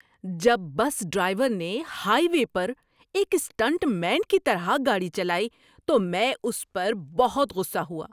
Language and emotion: Urdu, angry